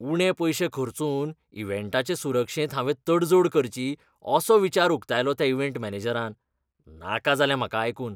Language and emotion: Goan Konkani, disgusted